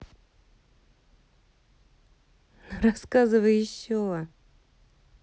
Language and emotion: Russian, positive